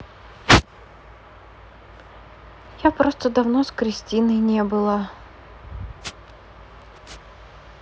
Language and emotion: Russian, sad